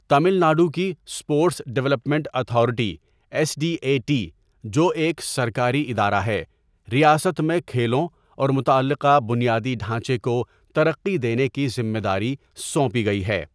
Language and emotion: Urdu, neutral